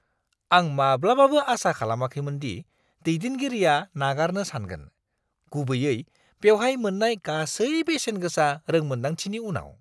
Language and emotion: Bodo, surprised